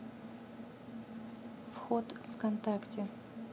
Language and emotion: Russian, neutral